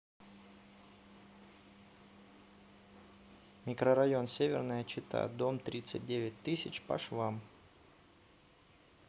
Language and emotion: Russian, neutral